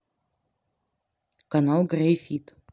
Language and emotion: Russian, neutral